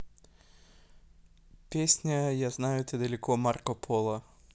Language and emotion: Russian, neutral